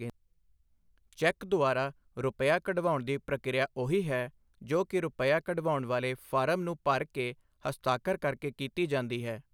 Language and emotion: Punjabi, neutral